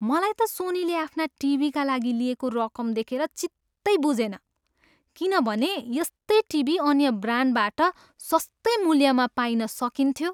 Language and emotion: Nepali, disgusted